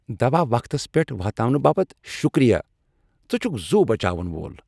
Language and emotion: Kashmiri, happy